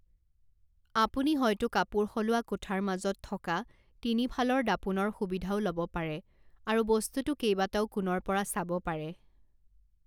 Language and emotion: Assamese, neutral